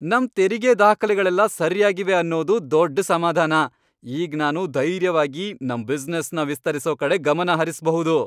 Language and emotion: Kannada, happy